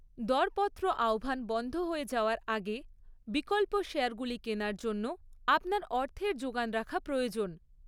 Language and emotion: Bengali, neutral